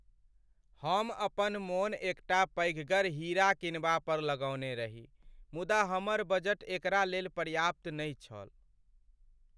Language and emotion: Maithili, sad